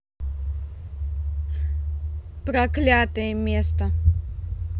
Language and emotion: Russian, neutral